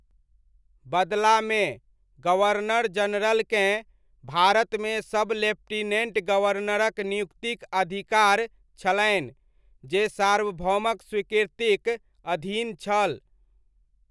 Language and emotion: Maithili, neutral